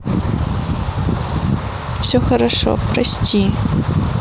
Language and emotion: Russian, sad